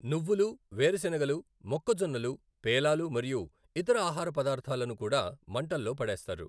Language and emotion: Telugu, neutral